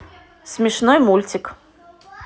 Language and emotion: Russian, neutral